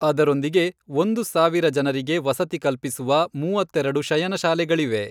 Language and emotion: Kannada, neutral